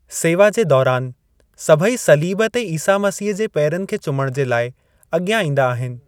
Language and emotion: Sindhi, neutral